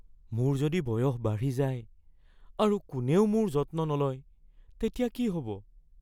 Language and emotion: Assamese, fearful